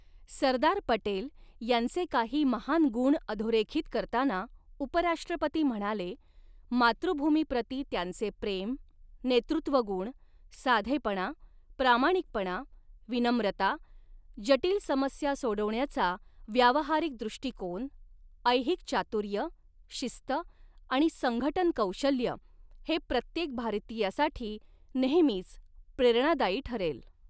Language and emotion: Marathi, neutral